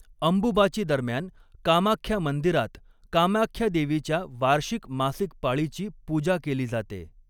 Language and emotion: Marathi, neutral